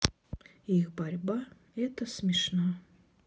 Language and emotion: Russian, sad